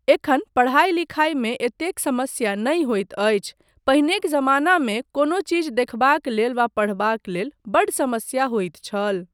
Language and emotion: Maithili, neutral